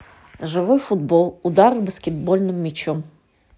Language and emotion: Russian, neutral